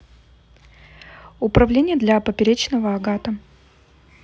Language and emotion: Russian, neutral